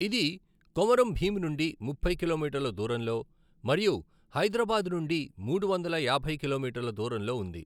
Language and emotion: Telugu, neutral